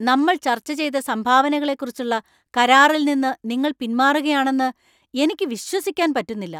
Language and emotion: Malayalam, angry